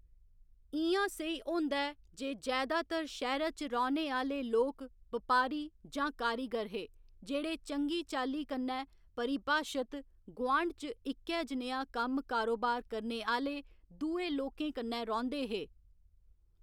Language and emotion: Dogri, neutral